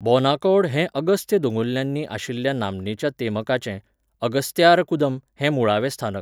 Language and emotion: Goan Konkani, neutral